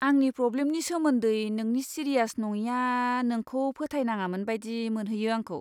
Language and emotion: Bodo, disgusted